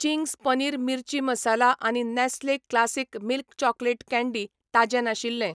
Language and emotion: Goan Konkani, neutral